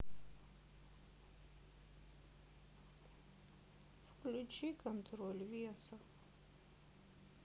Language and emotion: Russian, sad